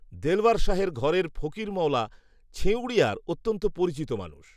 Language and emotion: Bengali, neutral